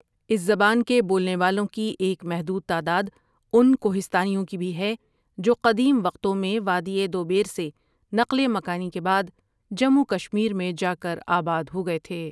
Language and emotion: Urdu, neutral